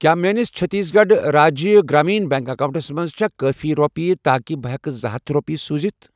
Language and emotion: Kashmiri, neutral